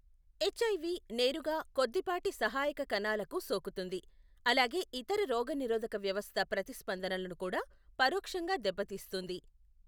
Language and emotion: Telugu, neutral